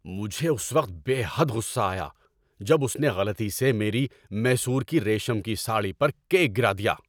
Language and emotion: Urdu, angry